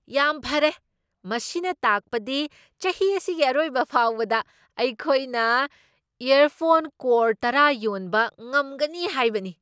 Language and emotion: Manipuri, surprised